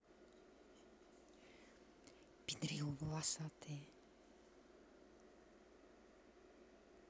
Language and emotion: Russian, neutral